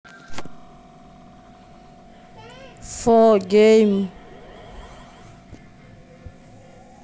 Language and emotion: Russian, neutral